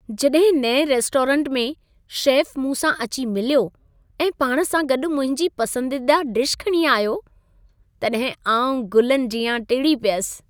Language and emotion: Sindhi, happy